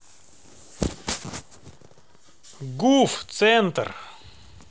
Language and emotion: Russian, neutral